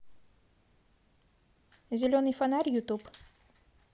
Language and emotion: Russian, neutral